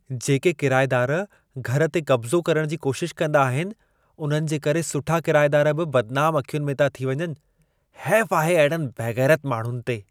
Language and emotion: Sindhi, disgusted